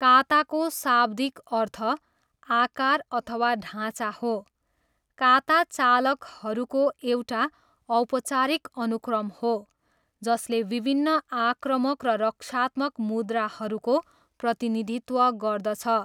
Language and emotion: Nepali, neutral